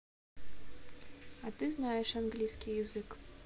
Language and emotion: Russian, neutral